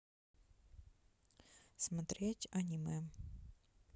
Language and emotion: Russian, neutral